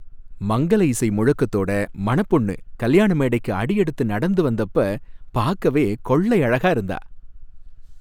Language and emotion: Tamil, happy